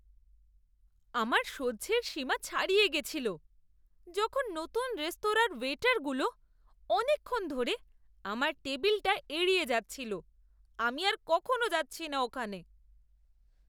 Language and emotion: Bengali, disgusted